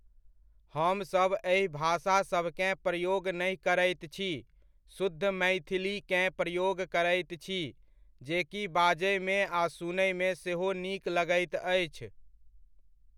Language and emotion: Maithili, neutral